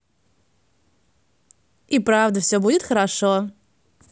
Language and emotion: Russian, positive